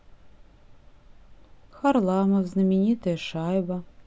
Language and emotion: Russian, neutral